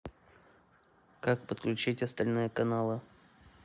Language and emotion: Russian, neutral